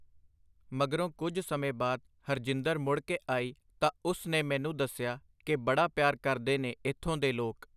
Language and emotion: Punjabi, neutral